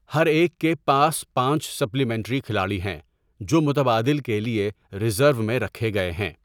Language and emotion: Urdu, neutral